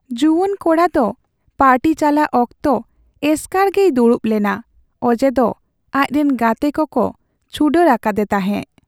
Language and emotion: Santali, sad